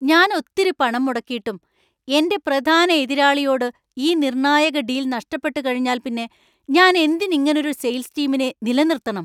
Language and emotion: Malayalam, angry